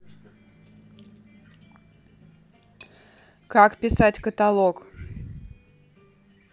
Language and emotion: Russian, neutral